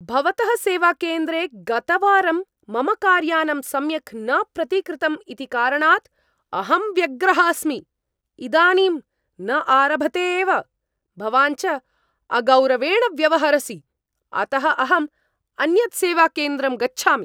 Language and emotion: Sanskrit, angry